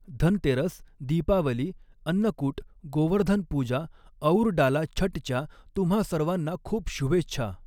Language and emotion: Marathi, neutral